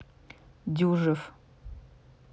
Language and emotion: Russian, neutral